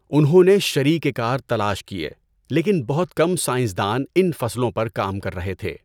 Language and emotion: Urdu, neutral